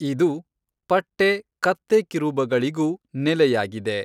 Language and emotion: Kannada, neutral